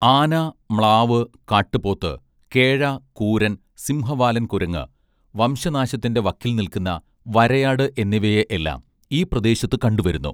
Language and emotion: Malayalam, neutral